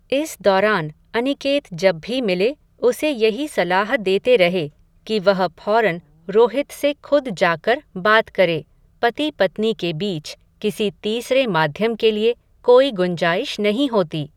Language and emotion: Hindi, neutral